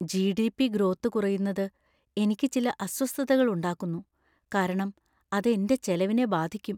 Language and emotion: Malayalam, fearful